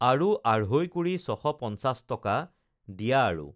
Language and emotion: Assamese, neutral